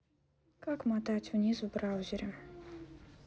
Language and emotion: Russian, neutral